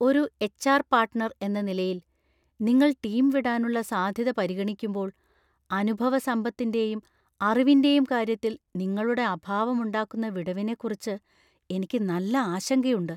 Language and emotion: Malayalam, fearful